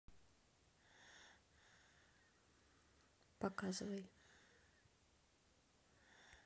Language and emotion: Russian, neutral